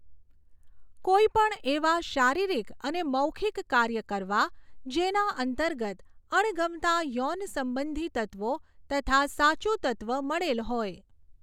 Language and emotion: Gujarati, neutral